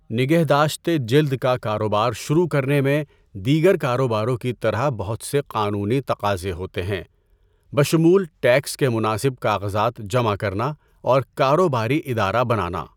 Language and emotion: Urdu, neutral